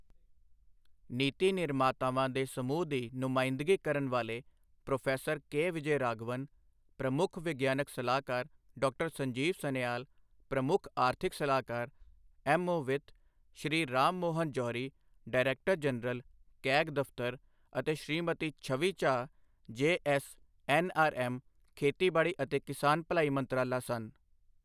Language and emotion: Punjabi, neutral